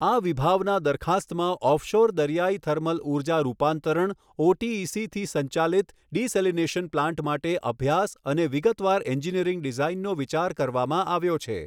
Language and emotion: Gujarati, neutral